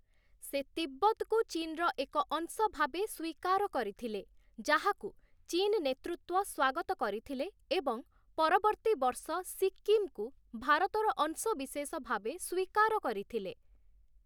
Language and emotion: Odia, neutral